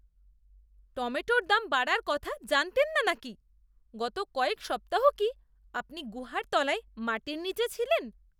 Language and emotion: Bengali, disgusted